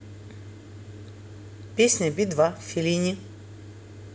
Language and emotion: Russian, neutral